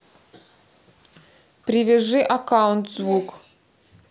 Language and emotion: Russian, neutral